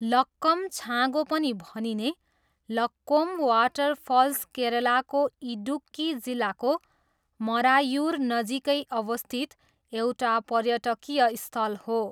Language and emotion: Nepali, neutral